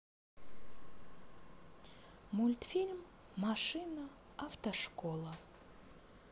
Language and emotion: Russian, positive